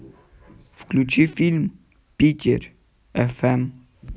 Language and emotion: Russian, neutral